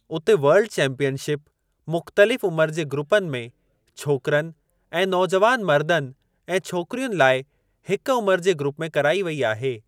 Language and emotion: Sindhi, neutral